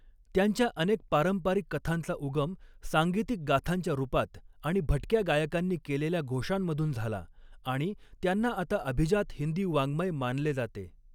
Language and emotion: Marathi, neutral